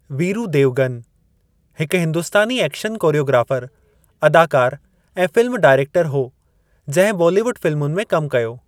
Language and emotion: Sindhi, neutral